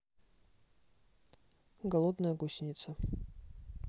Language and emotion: Russian, neutral